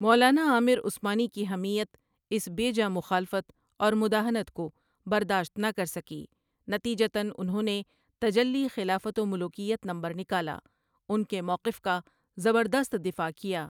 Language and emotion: Urdu, neutral